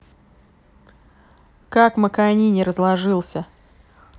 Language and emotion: Russian, angry